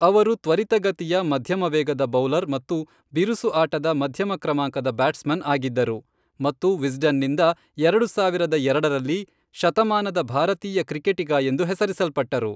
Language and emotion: Kannada, neutral